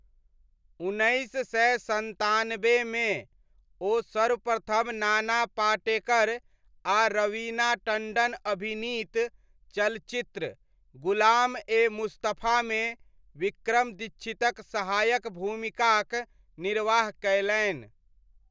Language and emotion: Maithili, neutral